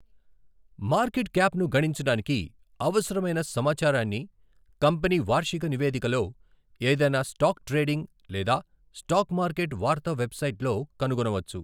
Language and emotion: Telugu, neutral